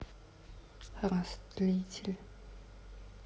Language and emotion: Russian, neutral